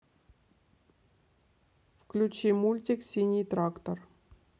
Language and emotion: Russian, neutral